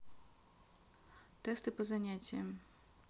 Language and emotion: Russian, neutral